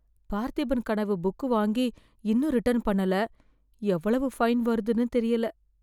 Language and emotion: Tamil, fearful